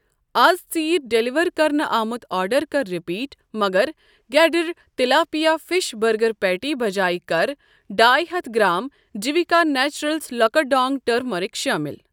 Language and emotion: Kashmiri, neutral